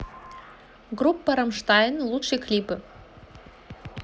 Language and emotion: Russian, positive